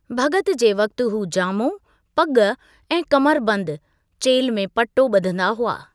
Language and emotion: Sindhi, neutral